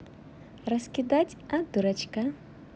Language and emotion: Russian, positive